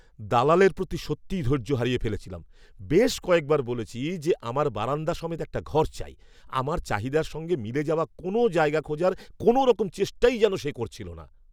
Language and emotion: Bengali, angry